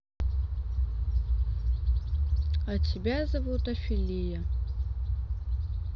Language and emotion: Russian, neutral